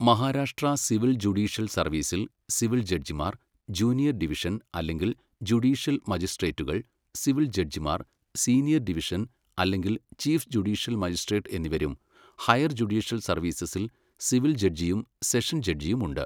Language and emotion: Malayalam, neutral